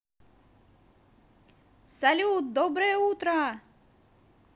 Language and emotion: Russian, positive